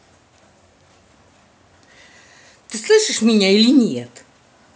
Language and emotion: Russian, angry